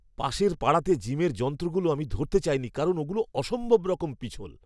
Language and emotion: Bengali, disgusted